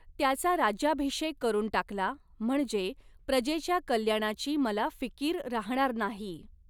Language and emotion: Marathi, neutral